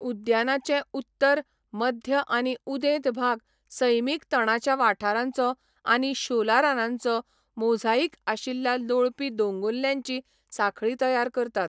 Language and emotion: Goan Konkani, neutral